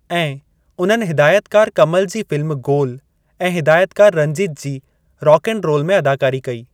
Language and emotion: Sindhi, neutral